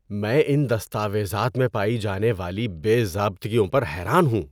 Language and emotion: Urdu, disgusted